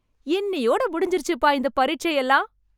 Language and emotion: Tamil, happy